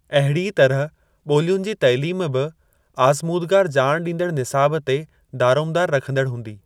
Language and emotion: Sindhi, neutral